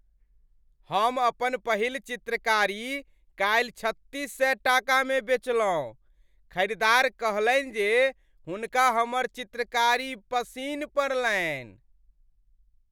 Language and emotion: Maithili, happy